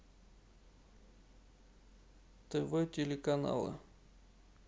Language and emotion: Russian, neutral